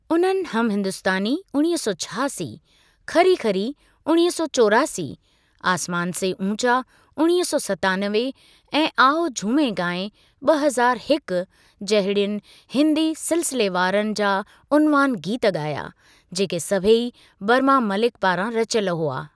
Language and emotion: Sindhi, neutral